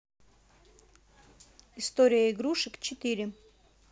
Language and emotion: Russian, neutral